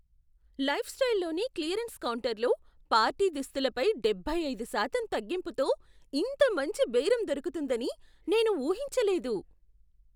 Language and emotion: Telugu, surprised